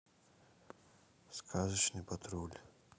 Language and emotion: Russian, sad